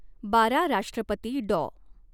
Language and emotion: Marathi, neutral